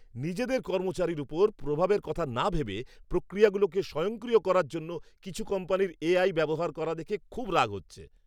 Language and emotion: Bengali, angry